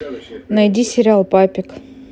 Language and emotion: Russian, neutral